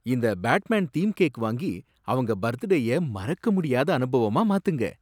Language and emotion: Tamil, surprised